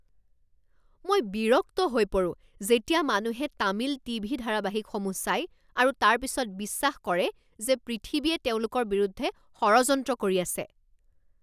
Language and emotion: Assamese, angry